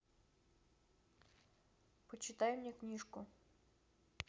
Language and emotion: Russian, neutral